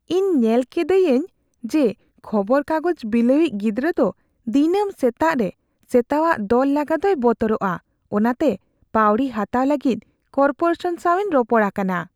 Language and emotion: Santali, fearful